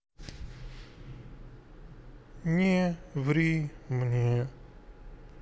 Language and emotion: Russian, neutral